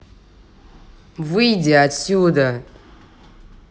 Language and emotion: Russian, angry